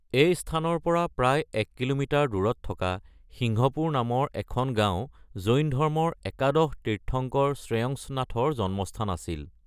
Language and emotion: Assamese, neutral